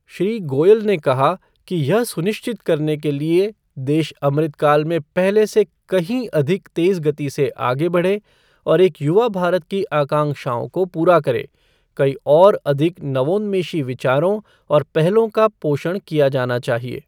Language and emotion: Hindi, neutral